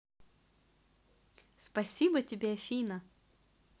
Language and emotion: Russian, positive